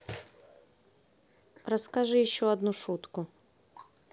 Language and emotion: Russian, neutral